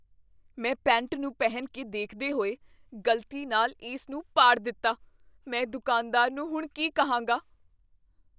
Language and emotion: Punjabi, fearful